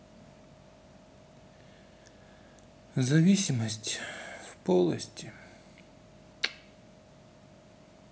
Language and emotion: Russian, sad